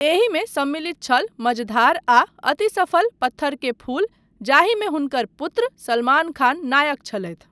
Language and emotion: Maithili, neutral